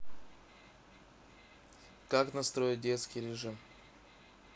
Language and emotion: Russian, neutral